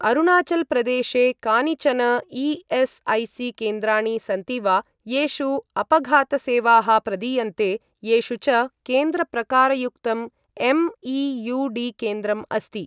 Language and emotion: Sanskrit, neutral